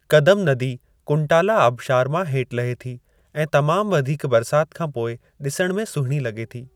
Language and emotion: Sindhi, neutral